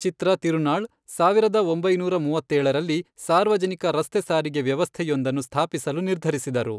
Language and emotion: Kannada, neutral